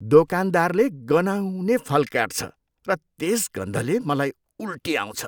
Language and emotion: Nepali, disgusted